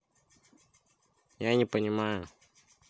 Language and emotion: Russian, neutral